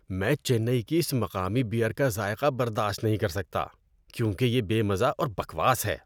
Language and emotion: Urdu, disgusted